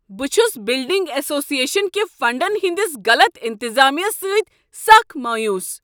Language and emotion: Kashmiri, angry